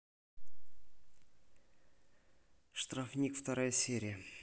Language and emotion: Russian, neutral